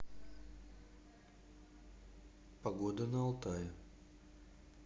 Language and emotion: Russian, neutral